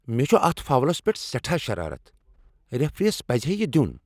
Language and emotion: Kashmiri, angry